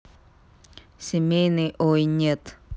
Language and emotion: Russian, neutral